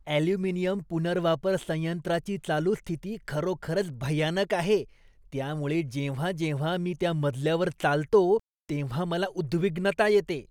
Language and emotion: Marathi, disgusted